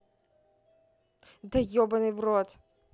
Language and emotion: Russian, angry